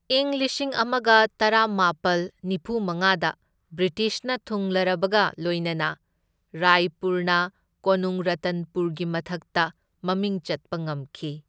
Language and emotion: Manipuri, neutral